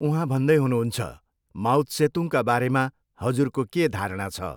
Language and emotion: Nepali, neutral